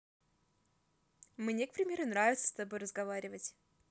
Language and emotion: Russian, positive